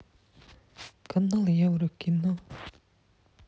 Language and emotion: Russian, neutral